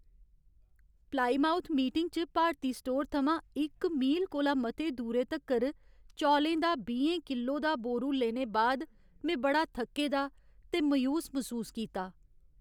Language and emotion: Dogri, sad